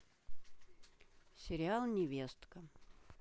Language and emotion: Russian, neutral